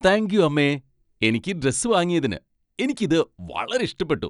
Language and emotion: Malayalam, happy